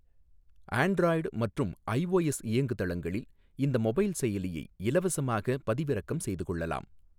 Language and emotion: Tamil, neutral